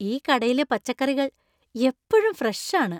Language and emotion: Malayalam, happy